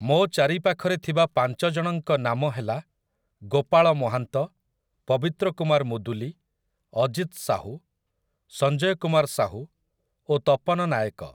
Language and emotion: Odia, neutral